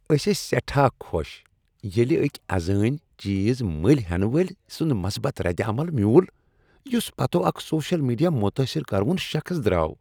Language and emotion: Kashmiri, happy